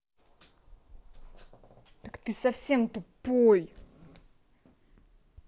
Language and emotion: Russian, angry